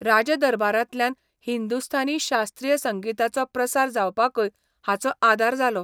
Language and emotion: Goan Konkani, neutral